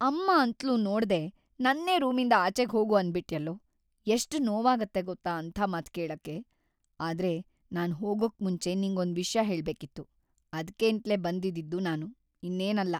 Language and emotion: Kannada, sad